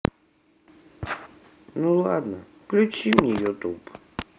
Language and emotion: Russian, sad